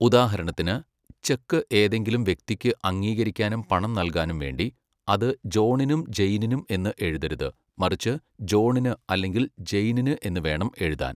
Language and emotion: Malayalam, neutral